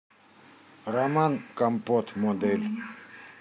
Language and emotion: Russian, neutral